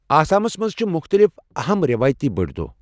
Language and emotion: Kashmiri, neutral